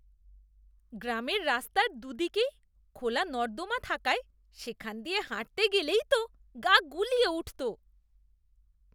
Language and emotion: Bengali, disgusted